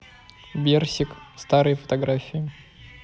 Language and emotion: Russian, neutral